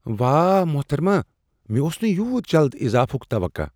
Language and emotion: Kashmiri, surprised